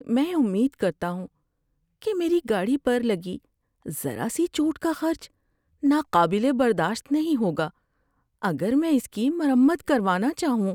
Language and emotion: Urdu, fearful